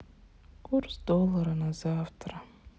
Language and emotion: Russian, sad